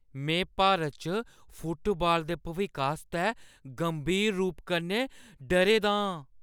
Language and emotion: Dogri, fearful